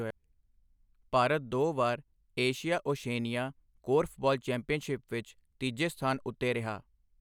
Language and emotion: Punjabi, neutral